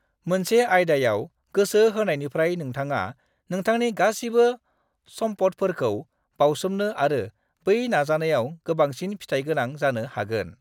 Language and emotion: Bodo, neutral